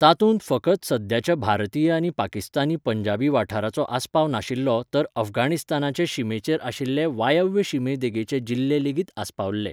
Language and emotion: Goan Konkani, neutral